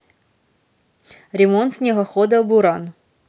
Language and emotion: Russian, neutral